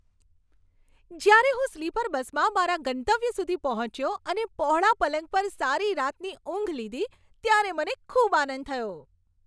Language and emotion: Gujarati, happy